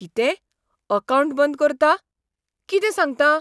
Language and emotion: Goan Konkani, surprised